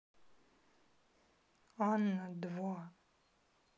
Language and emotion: Russian, sad